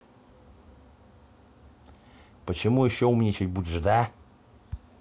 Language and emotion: Russian, angry